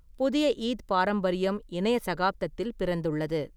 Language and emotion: Tamil, neutral